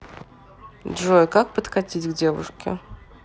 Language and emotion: Russian, neutral